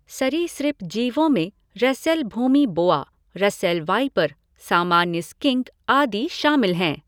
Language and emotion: Hindi, neutral